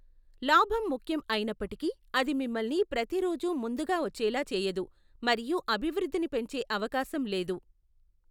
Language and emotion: Telugu, neutral